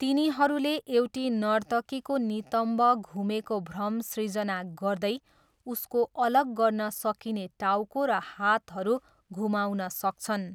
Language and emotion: Nepali, neutral